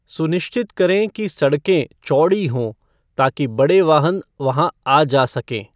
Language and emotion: Hindi, neutral